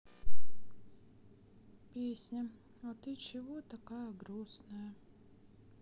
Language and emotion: Russian, sad